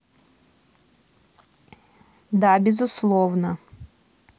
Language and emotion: Russian, neutral